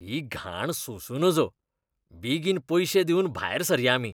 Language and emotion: Goan Konkani, disgusted